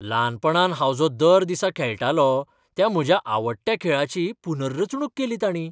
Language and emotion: Goan Konkani, surprised